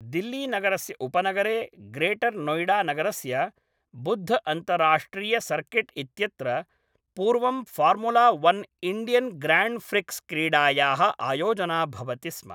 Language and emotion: Sanskrit, neutral